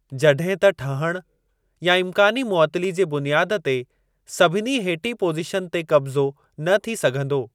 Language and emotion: Sindhi, neutral